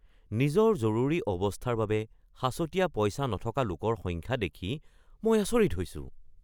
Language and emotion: Assamese, surprised